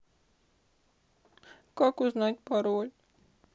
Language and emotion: Russian, sad